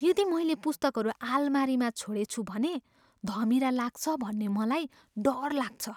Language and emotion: Nepali, fearful